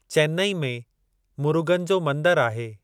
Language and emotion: Sindhi, neutral